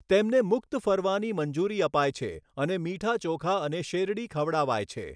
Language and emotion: Gujarati, neutral